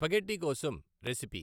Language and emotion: Telugu, neutral